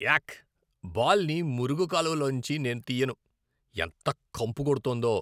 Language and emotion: Telugu, disgusted